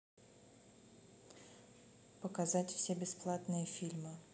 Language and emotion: Russian, neutral